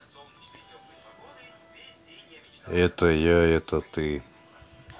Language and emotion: Russian, neutral